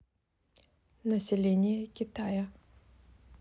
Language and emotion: Russian, neutral